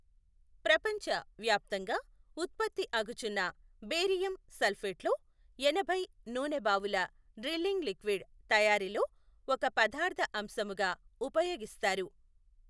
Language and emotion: Telugu, neutral